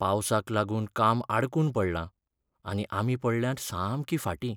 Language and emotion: Goan Konkani, sad